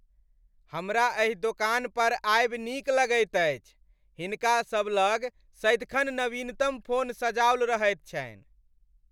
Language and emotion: Maithili, happy